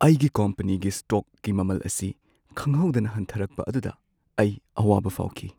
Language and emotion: Manipuri, sad